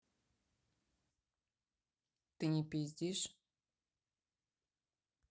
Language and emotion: Russian, neutral